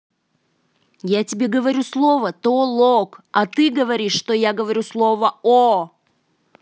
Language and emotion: Russian, angry